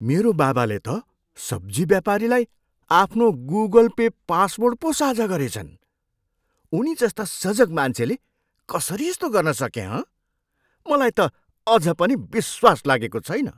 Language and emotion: Nepali, surprised